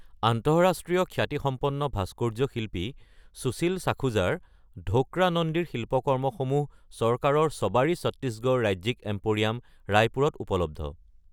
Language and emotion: Assamese, neutral